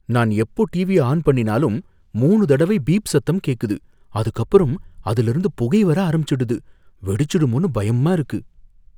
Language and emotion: Tamil, fearful